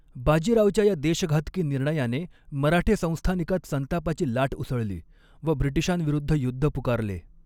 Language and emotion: Marathi, neutral